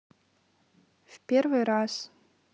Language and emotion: Russian, neutral